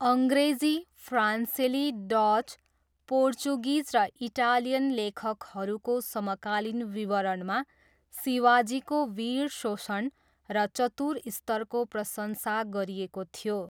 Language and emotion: Nepali, neutral